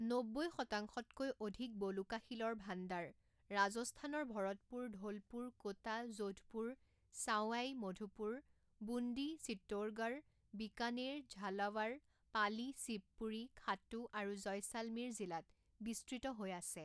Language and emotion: Assamese, neutral